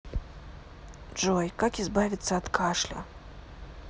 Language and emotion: Russian, neutral